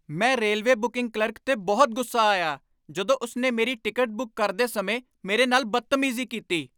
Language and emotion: Punjabi, angry